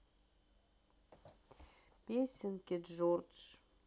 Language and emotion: Russian, sad